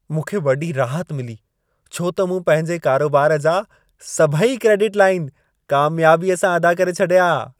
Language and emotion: Sindhi, happy